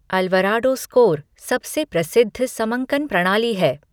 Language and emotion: Hindi, neutral